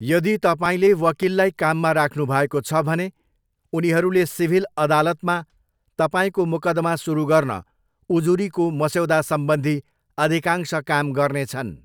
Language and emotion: Nepali, neutral